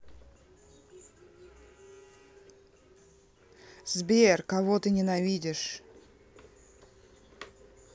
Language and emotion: Russian, neutral